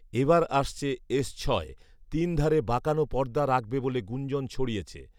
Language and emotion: Bengali, neutral